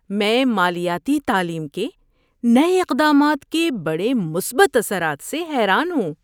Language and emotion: Urdu, surprised